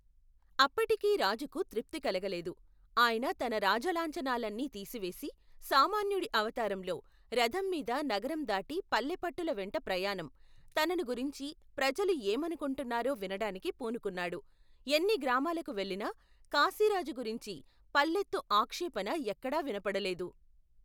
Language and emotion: Telugu, neutral